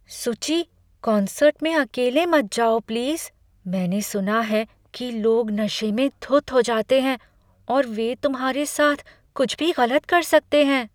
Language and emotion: Hindi, fearful